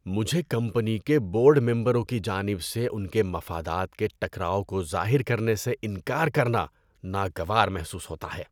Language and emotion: Urdu, disgusted